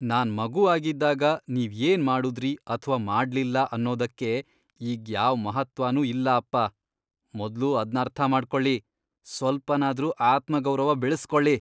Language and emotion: Kannada, disgusted